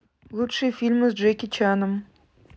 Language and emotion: Russian, neutral